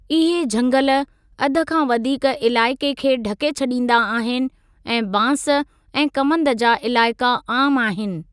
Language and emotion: Sindhi, neutral